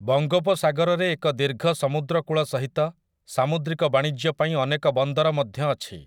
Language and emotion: Odia, neutral